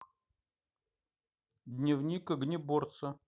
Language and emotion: Russian, neutral